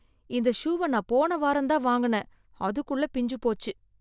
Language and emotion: Tamil, sad